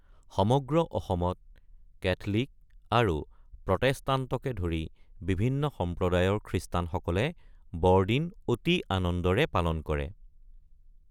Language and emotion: Assamese, neutral